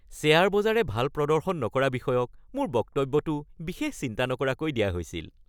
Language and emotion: Assamese, happy